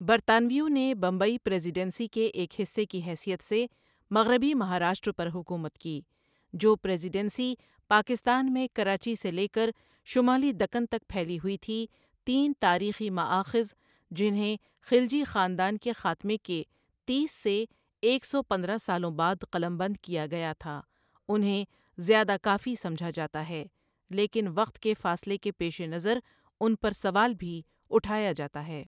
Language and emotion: Urdu, neutral